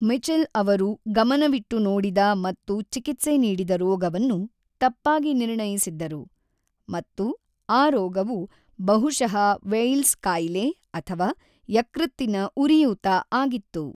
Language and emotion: Kannada, neutral